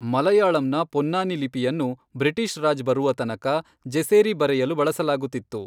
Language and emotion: Kannada, neutral